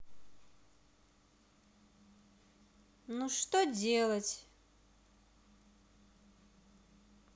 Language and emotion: Russian, neutral